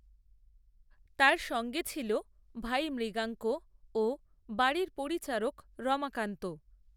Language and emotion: Bengali, neutral